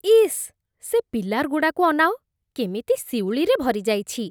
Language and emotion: Odia, disgusted